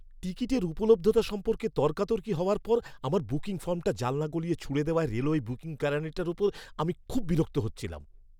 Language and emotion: Bengali, angry